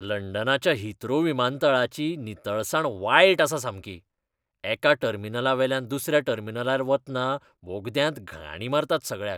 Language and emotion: Goan Konkani, disgusted